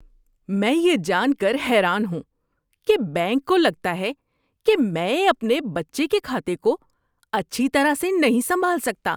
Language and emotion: Urdu, disgusted